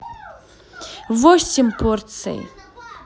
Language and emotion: Russian, positive